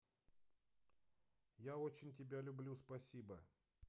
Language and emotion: Russian, positive